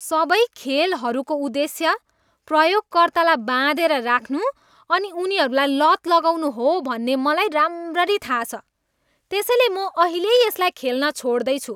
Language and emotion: Nepali, disgusted